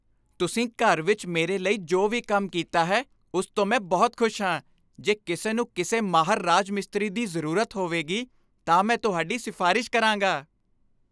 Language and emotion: Punjabi, happy